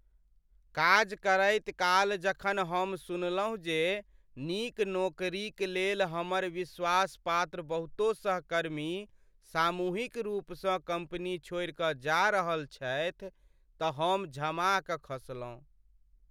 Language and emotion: Maithili, sad